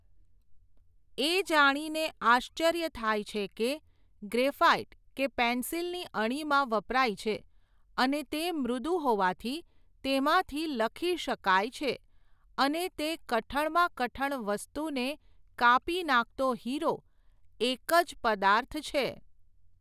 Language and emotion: Gujarati, neutral